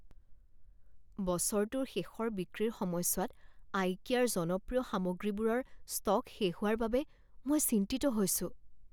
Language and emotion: Assamese, fearful